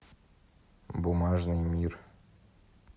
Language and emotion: Russian, neutral